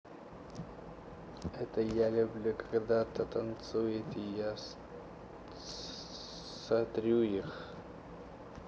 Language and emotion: Russian, neutral